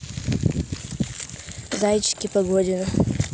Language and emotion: Russian, neutral